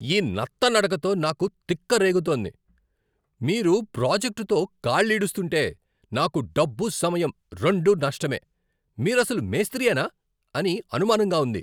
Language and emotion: Telugu, angry